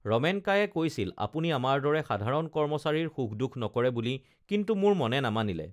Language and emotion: Assamese, neutral